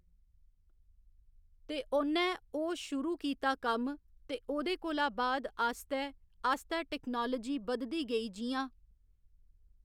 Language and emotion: Dogri, neutral